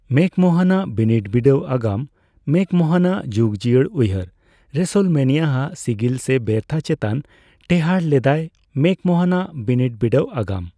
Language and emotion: Santali, neutral